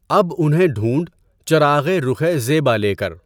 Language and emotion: Urdu, neutral